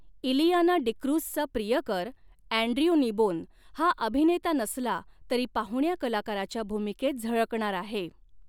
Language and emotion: Marathi, neutral